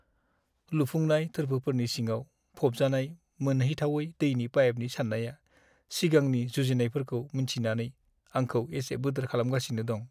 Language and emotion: Bodo, sad